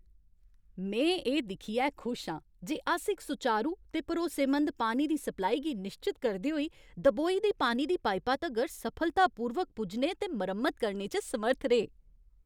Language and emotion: Dogri, happy